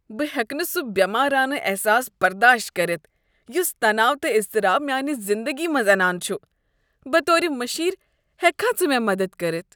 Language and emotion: Kashmiri, disgusted